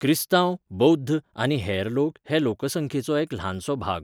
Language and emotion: Goan Konkani, neutral